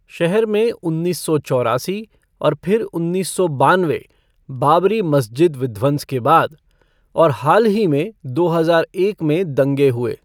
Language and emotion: Hindi, neutral